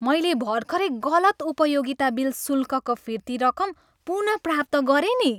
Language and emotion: Nepali, happy